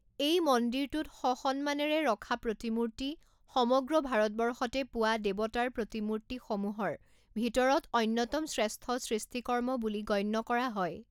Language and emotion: Assamese, neutral